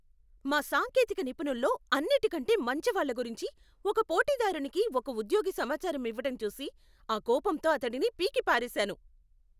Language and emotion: Telugu, angry